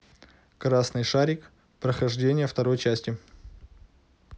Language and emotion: Russian, neutral